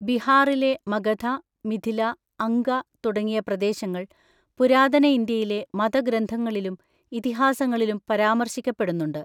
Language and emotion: Malayalam, neutral